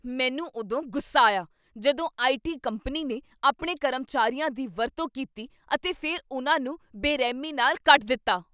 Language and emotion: Punjabi, angry